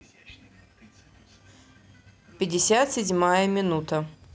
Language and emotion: Russian, neutral